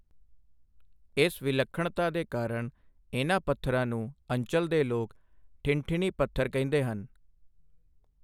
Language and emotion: Punjabi, neutral